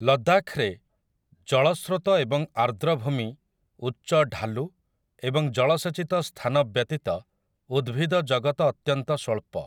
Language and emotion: Odia, neutral